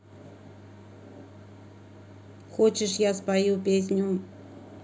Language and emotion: Russian, neutral